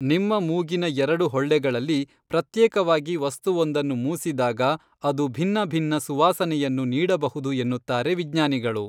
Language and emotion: Kannada, neutral